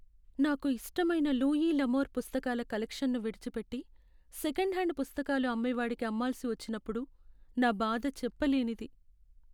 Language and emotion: Telugu, sad